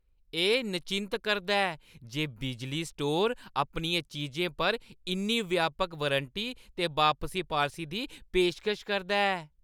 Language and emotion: Dogri, happy